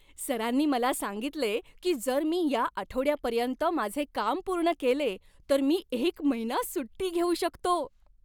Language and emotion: Marathi, happy